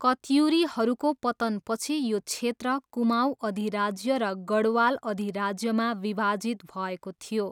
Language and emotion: Nepali, neutral